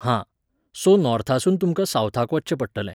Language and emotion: Goan Konkani, neutral